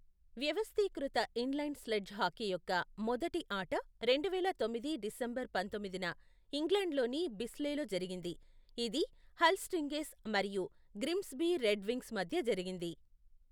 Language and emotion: Telugu, neutral